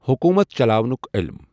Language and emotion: Kashmiri, neutral